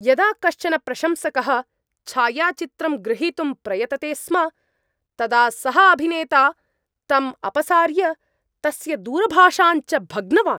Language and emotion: Sanskrit, angry